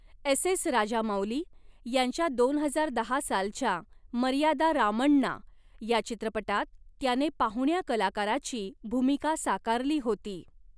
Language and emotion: Marathi, neutral